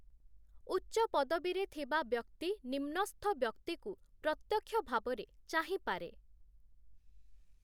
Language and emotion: Odia, neutral